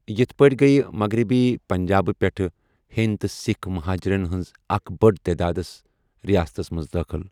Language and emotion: Kashmiri, neutral